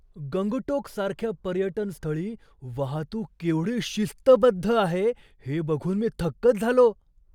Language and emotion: Marathi, surprised